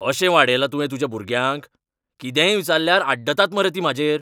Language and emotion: Goan Konkani, angry